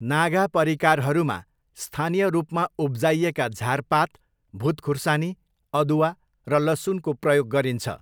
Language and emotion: Nepali, neutral